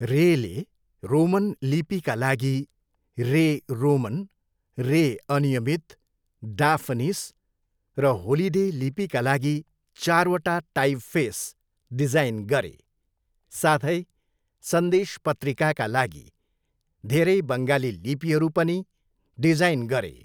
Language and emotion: Nepali, neutral